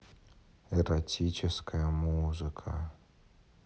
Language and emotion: Russian, neutral